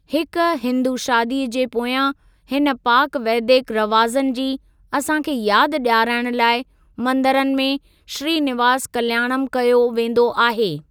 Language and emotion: Sindhi, neutral